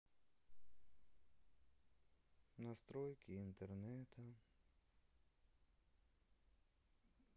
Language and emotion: Russian, sad